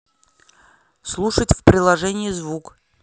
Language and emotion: Russian, neutral